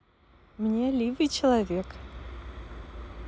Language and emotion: Russian, positive